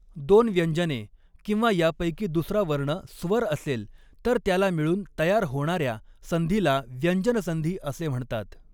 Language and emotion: Marathi, neutral